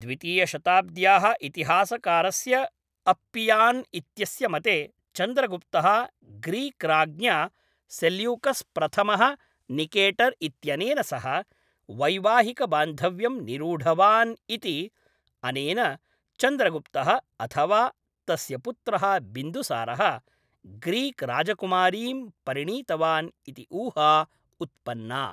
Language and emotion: Sanskrit, neutral